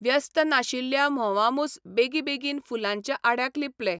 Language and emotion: Goan Konkani, neutral